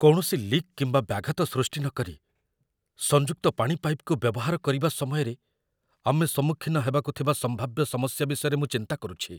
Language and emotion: Odia, fearful